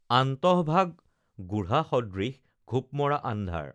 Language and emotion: Assamese, neutral